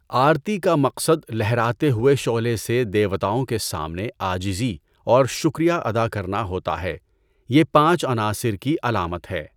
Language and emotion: Urdu, neutral